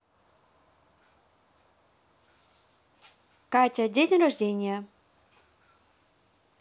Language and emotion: Russian, neutral